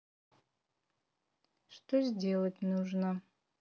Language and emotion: Russian, neutral